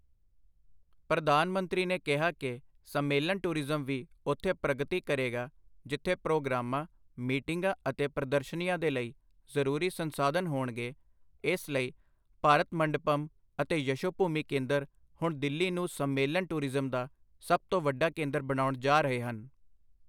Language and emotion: Punjabi, neutral